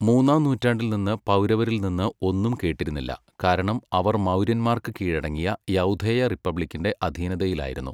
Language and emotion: Malayalam, neutral